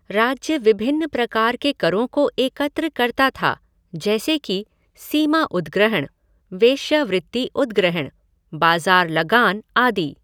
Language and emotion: Hindi, neutral